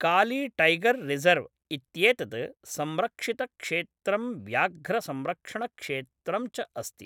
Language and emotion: Sanskrit, neutral